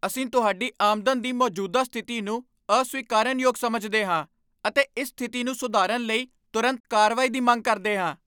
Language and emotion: Punjabi, angry